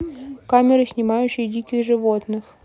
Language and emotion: Russian, neutral